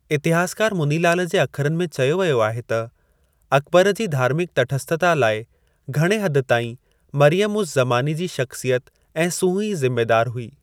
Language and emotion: Sindhi, neutral